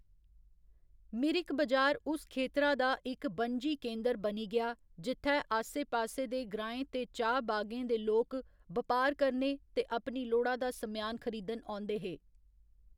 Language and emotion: Dogri, neutral